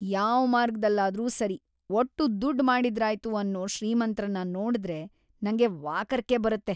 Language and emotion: Kannada, disgusted